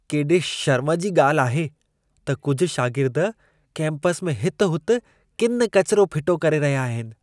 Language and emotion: Sindhi, disgusted